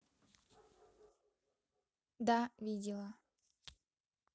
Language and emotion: Russian, neutral